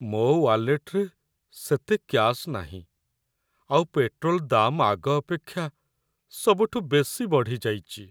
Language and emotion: Odia, sad